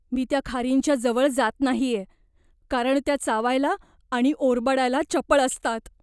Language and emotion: Marathi, fearful